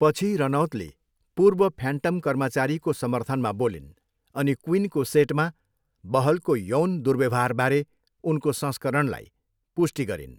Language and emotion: Nepali, neutral